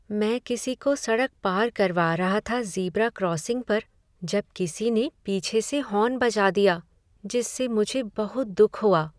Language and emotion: Hindi, sad